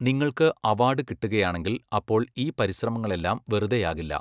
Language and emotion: Malayalam, neutral